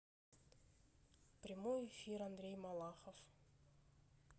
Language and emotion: Russian, neutral